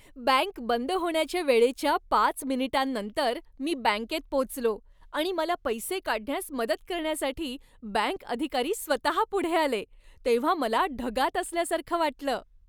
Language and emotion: Marathi, happy